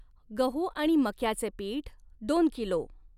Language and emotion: Marathi, neutral